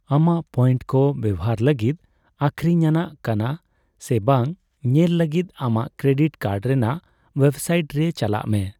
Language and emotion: Santali, neutral